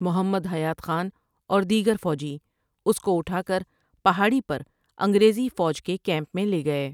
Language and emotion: Urdu, neutral